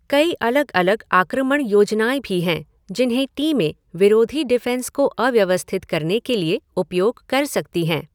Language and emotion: Hindi, neutral